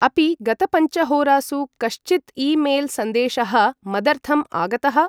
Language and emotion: Sanskrit, neutral